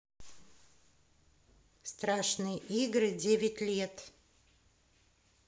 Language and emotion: Russian, neutral